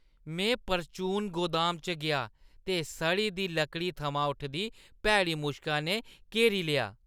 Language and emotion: Dogri, disgusted